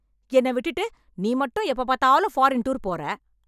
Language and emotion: Tamil, angry